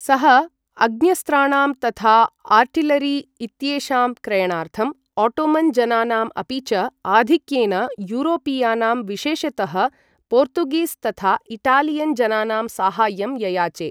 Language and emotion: Sanskrit, neutral